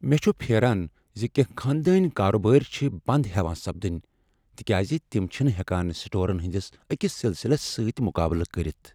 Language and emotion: Kashmiri, sad